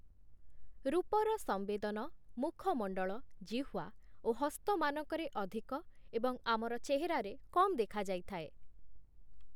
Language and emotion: Odia, neutral